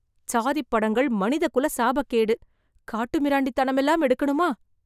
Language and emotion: Tamil, disgusted